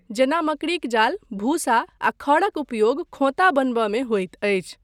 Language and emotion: Maithili, neutral